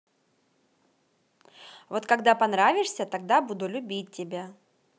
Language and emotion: Russian, positive